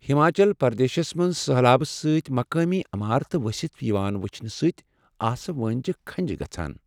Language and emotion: Kashmiri, sad